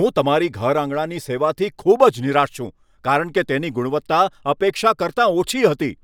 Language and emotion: Gujarati, angry